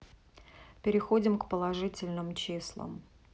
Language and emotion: Russian, neutral